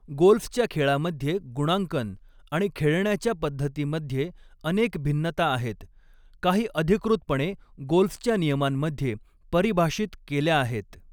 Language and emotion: Marathi, neutral